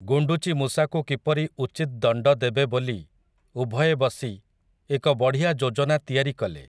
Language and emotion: Odia, neutral